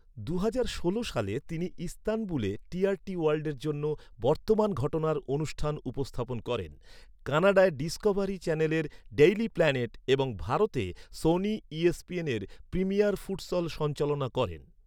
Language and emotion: Bengali, neutral